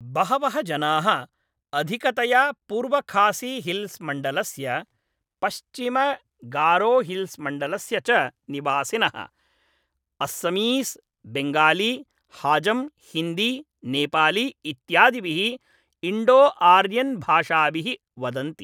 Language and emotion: Sanskrit, neutral